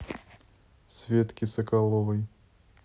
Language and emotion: Russian, neutral